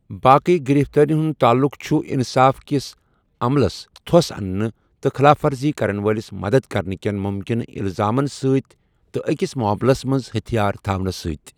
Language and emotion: Kashmiri, neutral